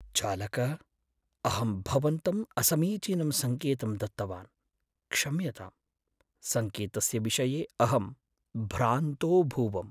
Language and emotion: Sanskrit, sad